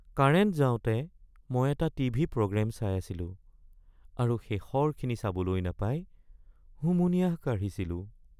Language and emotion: Assamese, sad